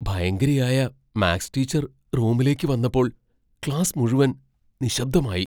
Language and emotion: Malayalam, fearful